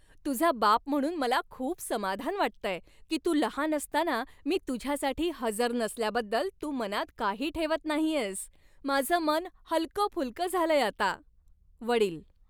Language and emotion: Marathi, happy